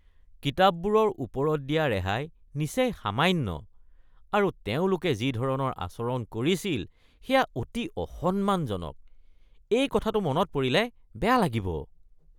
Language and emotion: Assamese, disgusted